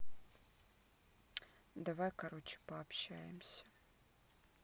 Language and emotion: Russian, sad